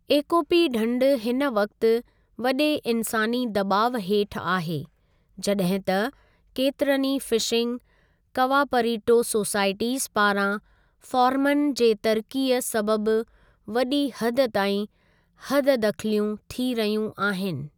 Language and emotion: Sindhi, neutral